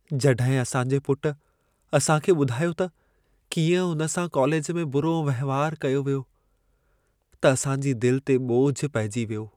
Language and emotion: Sindhi, sad